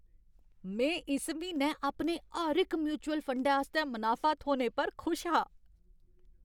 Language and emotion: Dogri, happy